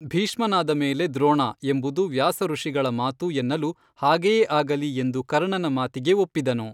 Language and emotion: Kannada, neutral